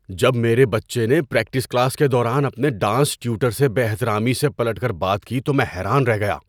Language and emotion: Urdu, surprised